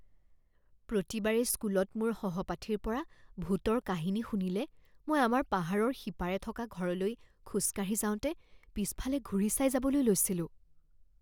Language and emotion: Assamese, fearful